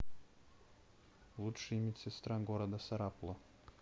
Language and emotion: Russian, neutral